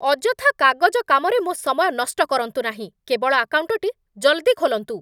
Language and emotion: Odia, angry